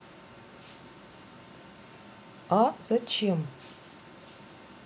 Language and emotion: Russian, neutral